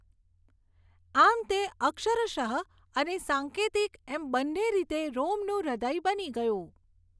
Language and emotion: Gujarati, neutral